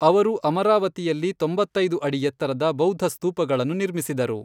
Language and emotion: Kannada, neutral